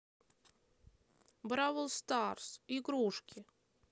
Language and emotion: Russian, neutral